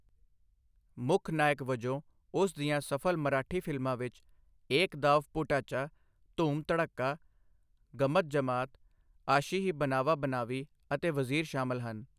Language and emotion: Punjabi, neutral